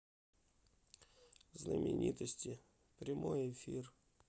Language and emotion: Russian, sad